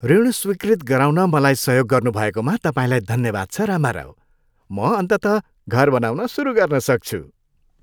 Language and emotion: Nepali, happy